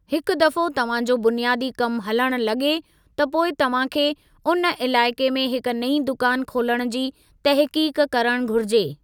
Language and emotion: Sindhi, neutral